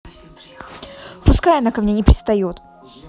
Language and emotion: Russian, angry